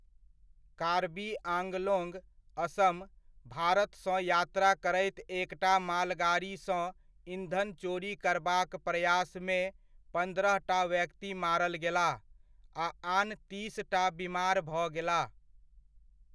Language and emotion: Maithili, neutral